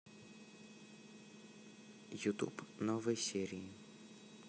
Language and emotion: Russian, neutral